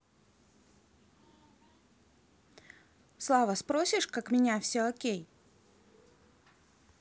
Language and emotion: Russian, neutral